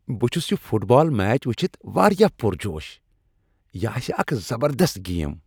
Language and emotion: Kashmiri, happy